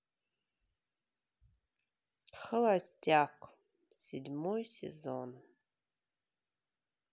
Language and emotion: Russian, sad